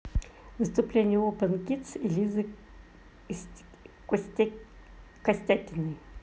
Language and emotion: Russian, neutral